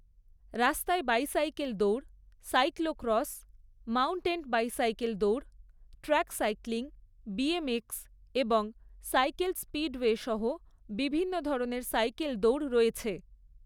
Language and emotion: Bengali, neutral